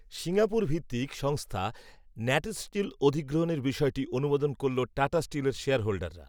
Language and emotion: Bengali, neutral